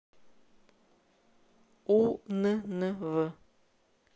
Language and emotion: Russian, neutral